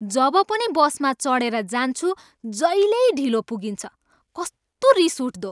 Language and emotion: Nepali, angry